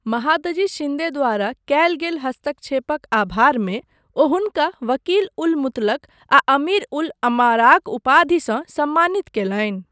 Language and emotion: Maithili, neutral